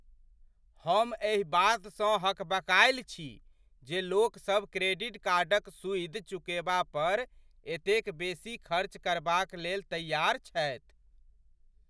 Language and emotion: Maithili, surprised